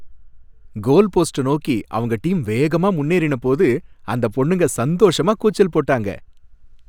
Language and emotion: Tamil, happy